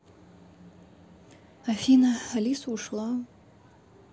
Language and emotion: Russian, sad